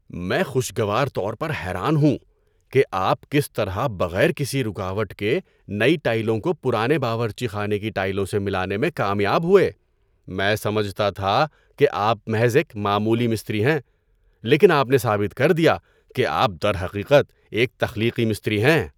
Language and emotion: Urdu, surprised